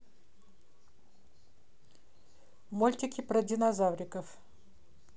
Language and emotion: Russian, neutral